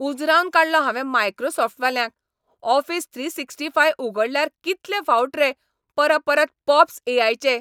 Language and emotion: Goan Konkani, angry